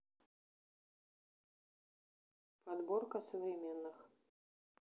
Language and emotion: Russian, neutral